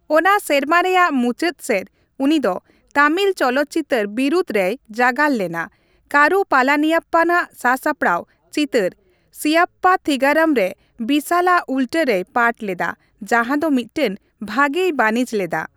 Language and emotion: Santali, neutral